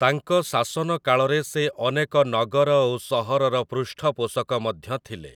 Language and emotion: Odia, neutral